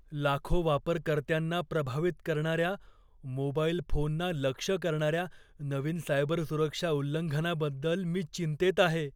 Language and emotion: Marathi, fearful